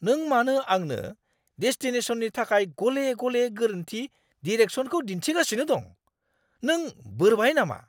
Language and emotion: Bodo, angry